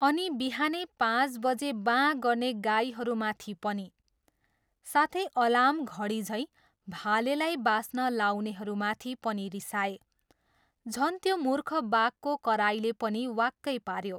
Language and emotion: Nepali, neutral